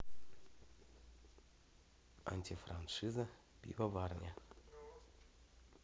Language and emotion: Russian, neutral